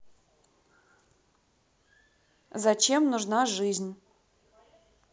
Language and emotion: Russian, neutral